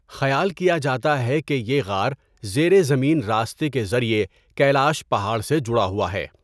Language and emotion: Urdu, neutral